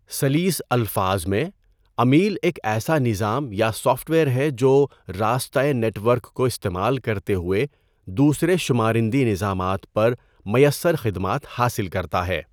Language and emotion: Urdu, neutral